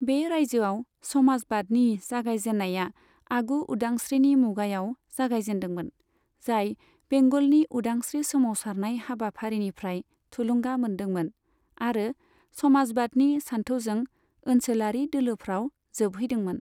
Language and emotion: Bodo, neutral